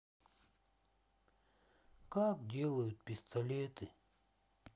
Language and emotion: Russian, sad